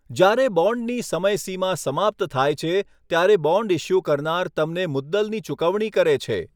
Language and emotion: Gujarati, neutral